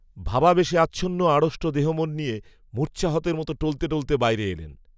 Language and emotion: Bengali, neutral